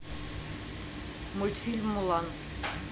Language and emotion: Russian, neutral